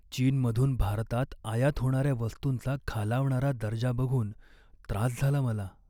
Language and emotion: Marathi, sad